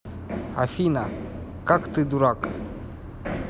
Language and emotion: Russian, neutral